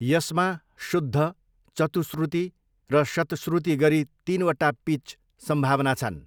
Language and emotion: Nepali, neutral